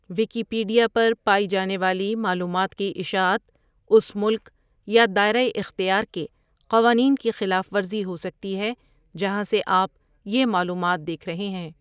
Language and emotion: Urdu, neutral